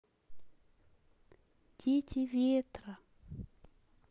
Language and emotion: Russian, sad